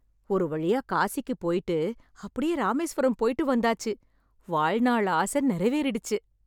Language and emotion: Tamil, happy